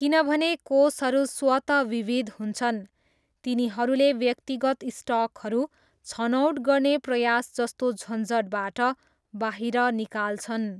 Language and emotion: Nepali, neutral